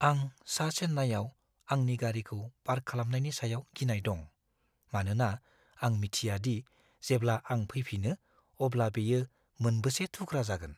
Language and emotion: Bodo, fearful